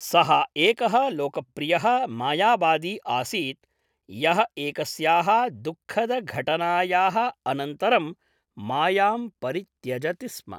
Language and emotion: Sanskrit, neutral